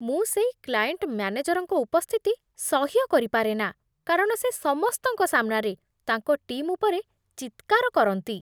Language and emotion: Odia, disgusted